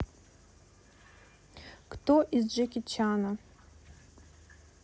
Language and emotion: Russian, neutral